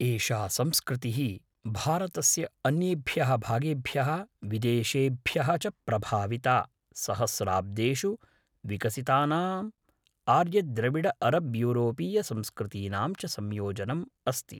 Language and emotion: Sanskrit, neutral